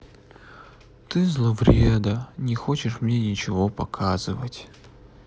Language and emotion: Russian, sad